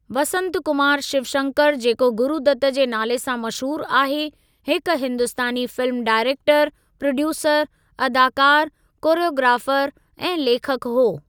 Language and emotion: Sindhi, neutral